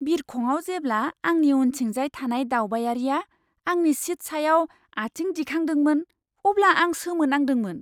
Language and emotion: Bodo, surprised